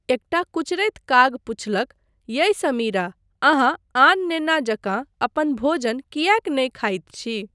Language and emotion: Maithili, neutral